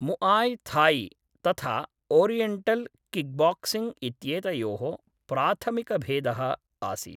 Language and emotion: Sanskrit, neutral